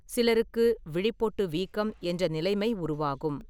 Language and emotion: Tamil, neutral